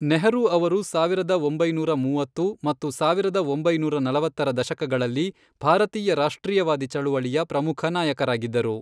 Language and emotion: Kannada, neutral